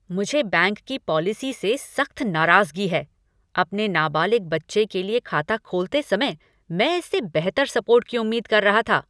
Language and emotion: Hindi, angry